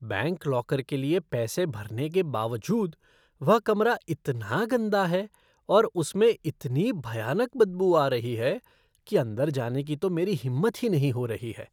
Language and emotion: Hindi, disgusted